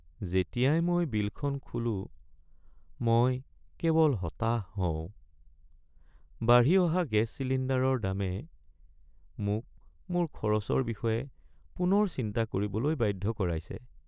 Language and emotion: Assamese, sad